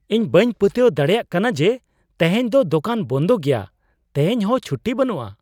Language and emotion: Santali, surprised